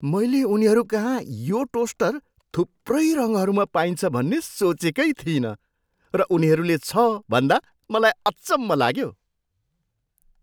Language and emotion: Nepali, surprised